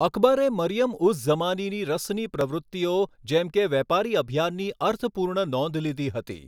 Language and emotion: Gujarati, neutral